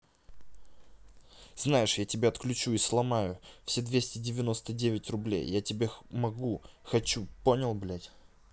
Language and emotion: Russian, angry